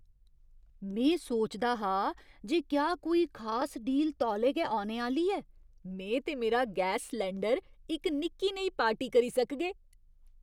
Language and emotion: Dogri, surprised